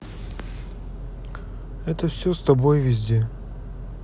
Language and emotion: Russian, neutral